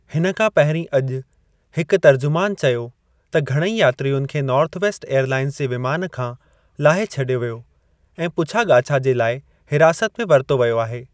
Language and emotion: Sindhi, neutral